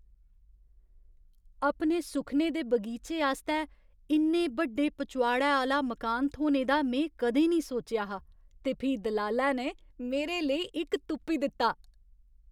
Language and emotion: Dogri, surprised